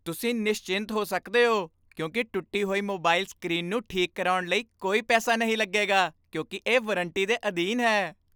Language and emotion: Punjabi, happy